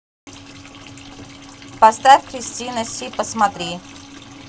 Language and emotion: Russian, neutral